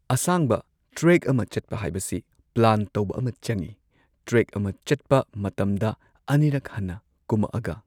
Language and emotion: Manipuri, neutral